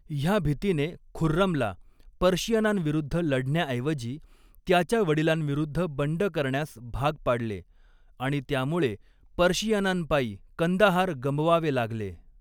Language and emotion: Marathi, neutral